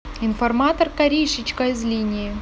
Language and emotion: Russian, neutral